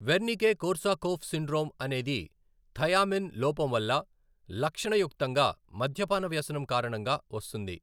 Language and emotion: Telugu, neutral